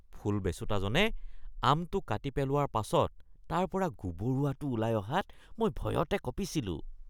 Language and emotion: Assamese, disgusted